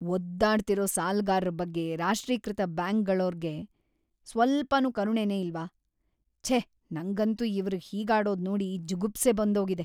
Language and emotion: Kannada, disgusted